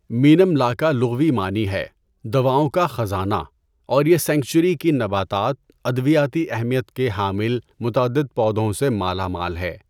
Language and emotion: Urdu, neutral